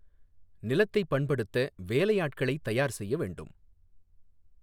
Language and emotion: Tamil, neutral